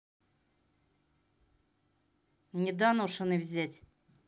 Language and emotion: Russian, angry